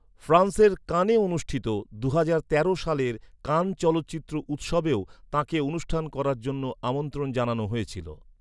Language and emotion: Bengali, neutral